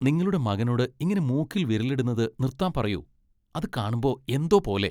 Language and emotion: Malayalam, disgusted